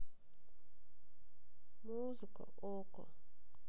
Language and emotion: Russian, sad